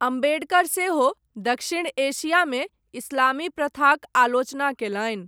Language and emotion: Maithili, neutral